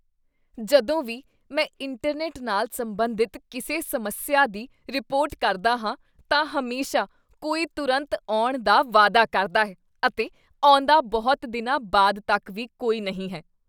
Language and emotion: Punjabi, disgusted